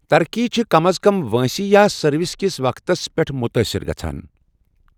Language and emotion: Kashmiri, neutral